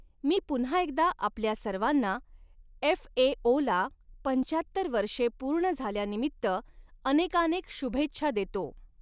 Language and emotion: Marathi, neutral